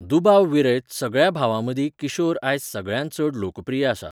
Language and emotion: Goan Konkani, neutral